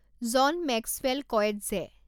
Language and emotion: Assamese, neutral